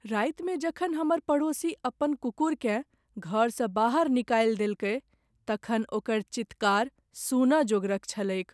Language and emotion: Maithili, sad